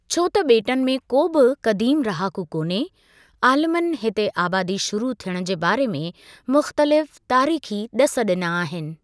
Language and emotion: Sindhi, neutral